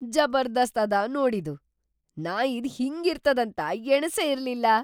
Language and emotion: Kannada, surprised